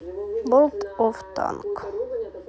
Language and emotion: Russian, neutral